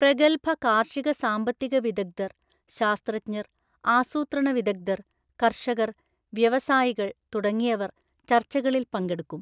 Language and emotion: Malayalam, neutral